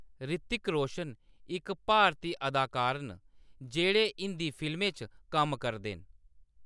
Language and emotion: Dogri, neutral